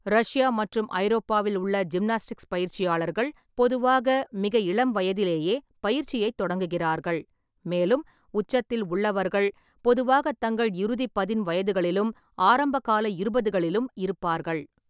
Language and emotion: Tamil, neutral